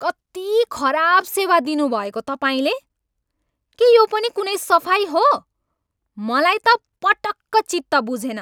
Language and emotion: Nepali, angry